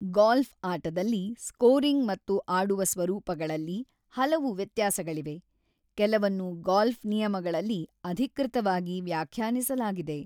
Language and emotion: Kannada, neutral